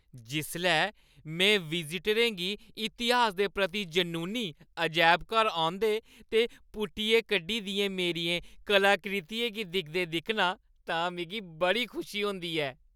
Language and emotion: Dogri, happy